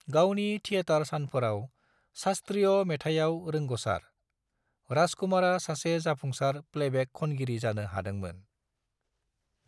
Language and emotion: Bodo, neutral